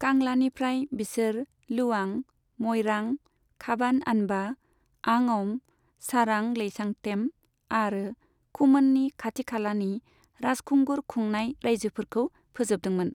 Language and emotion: Bodo, neutral